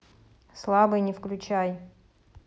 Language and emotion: Russian, neutral